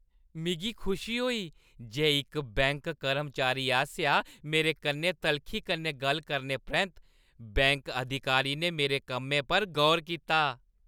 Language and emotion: Dogri, happy